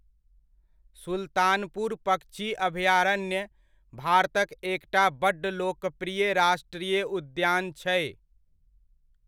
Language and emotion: Maithili, neutral